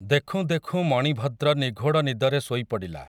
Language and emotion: Odia, neutral